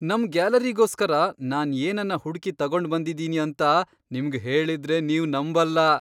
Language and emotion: Kannada, surprised